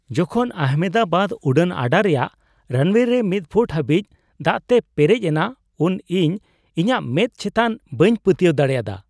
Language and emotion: Santali, surprised